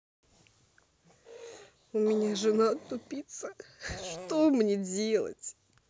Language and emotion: Russian, sad